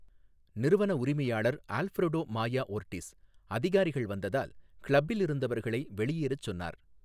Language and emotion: Tamil, neutral